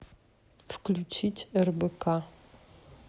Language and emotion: Russian, neutral